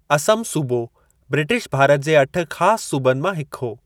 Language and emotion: Sindhi, neutral